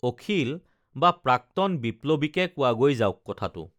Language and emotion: Assamese, neutral